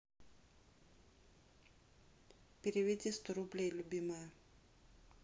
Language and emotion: Russian, neutral